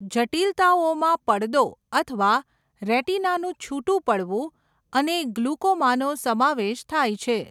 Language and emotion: Gujarati, neutral